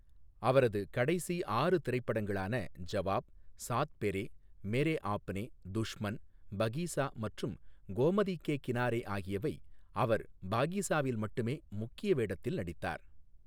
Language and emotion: Tamil, neutral